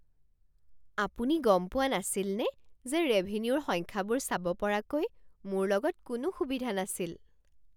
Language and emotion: Assamese, surprised